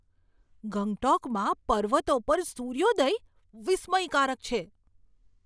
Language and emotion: Gujarati, surprised